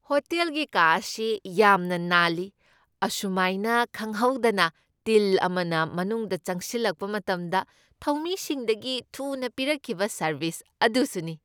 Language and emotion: Manipuri, happy